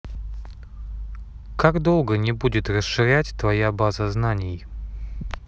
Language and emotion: Russian, neutral